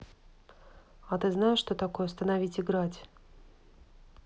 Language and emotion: Russian, neutral